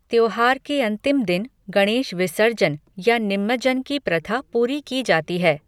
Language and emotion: Hindi, neutral